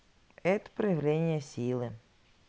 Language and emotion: Russian, neutral